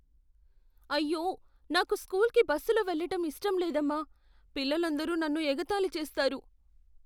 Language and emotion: Telugu, fearful